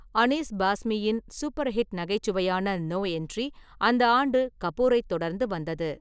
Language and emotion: Tamil, neutral